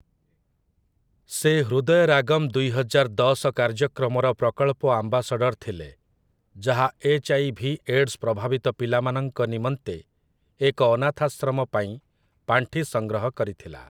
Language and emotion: Odia, neutral